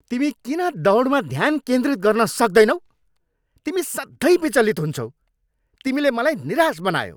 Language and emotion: Nepali, angry